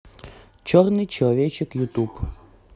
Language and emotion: Russian, neutral